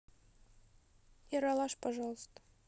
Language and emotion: Russian, neutral